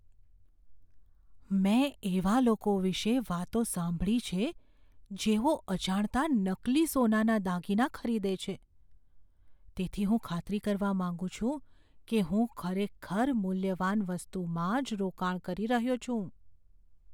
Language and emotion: Gujarati, fearful